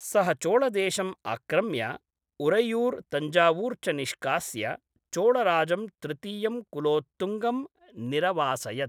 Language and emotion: Sanskrit, neutral